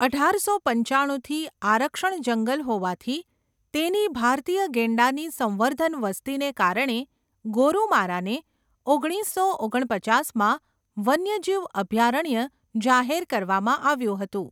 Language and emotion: Gujarati, neutral